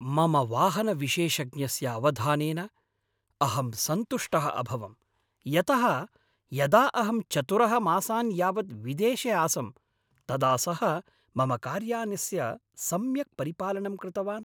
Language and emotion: Sanskrit, happy